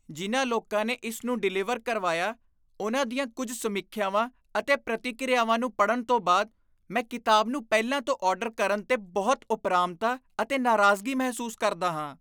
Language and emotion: Punjabi, disgusted